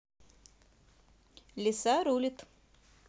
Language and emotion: Russian, positive